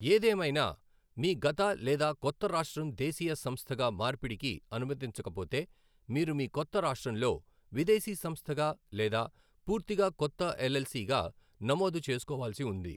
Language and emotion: Telugu, neutral